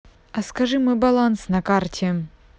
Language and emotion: Russian, neutral